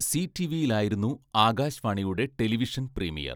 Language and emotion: Malayalam, neutral